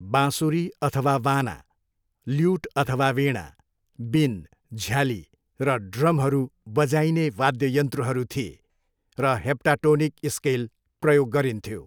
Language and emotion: Nepali, neutral